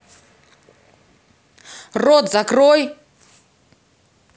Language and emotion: Russian, angry